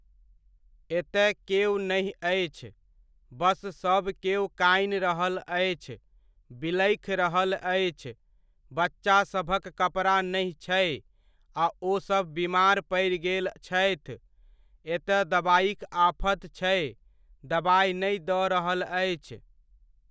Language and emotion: Maithili, neutral